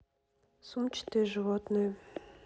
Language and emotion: Russian, neutral